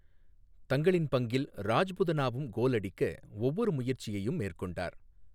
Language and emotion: Tamil, neutral